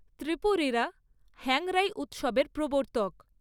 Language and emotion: Bengali, neutral